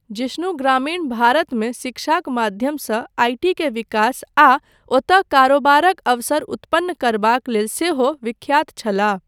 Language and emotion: Maithili, neutral